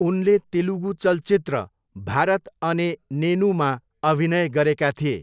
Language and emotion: Nepali, neutral